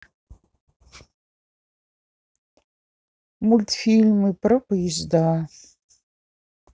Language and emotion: Russian, sad